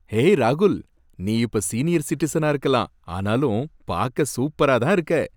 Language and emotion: Tamil, happy